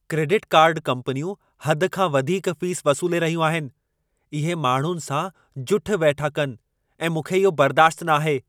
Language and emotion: Sindhi, angry